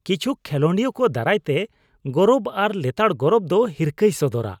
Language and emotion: Santali, disgusted